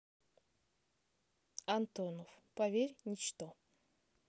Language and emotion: Russian, neutral